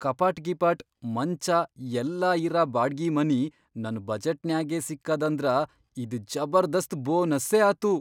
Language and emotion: Kannada, surprised